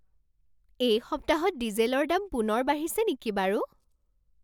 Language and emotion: Assamese, surprised